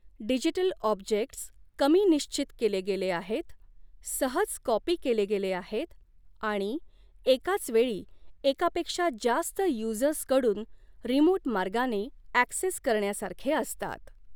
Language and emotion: Marathi, neutral